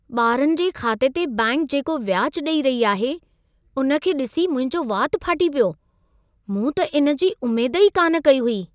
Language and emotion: Sindhi, surprised